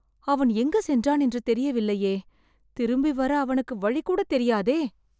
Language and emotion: Tamil, sad